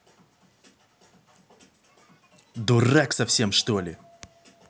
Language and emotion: Russian, angry